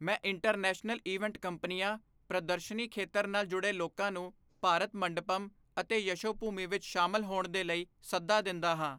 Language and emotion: Punjabi, neutral